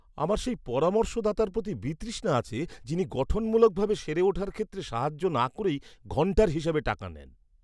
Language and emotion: Bengali, disgusted